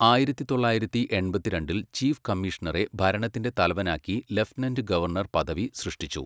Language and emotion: Malayalam, neutral